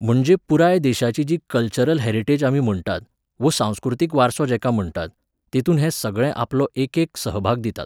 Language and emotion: Goan Konkani, neutral